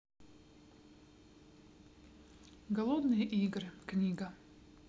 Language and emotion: Russian, neutral